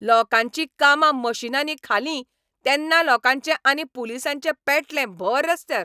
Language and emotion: Goan Konkani, angry